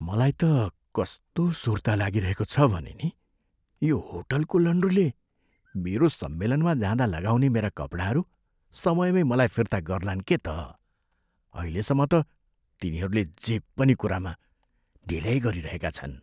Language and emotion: Nepali, fearful